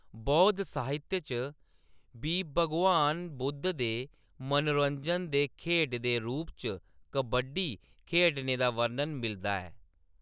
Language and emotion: Dogri, neutral